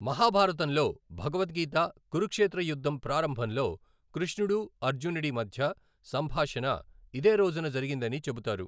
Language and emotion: Telugu, neutral